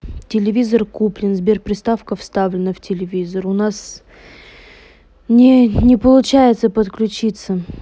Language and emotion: Russian, neutral